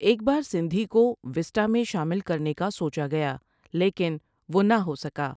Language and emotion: Urdu, neutral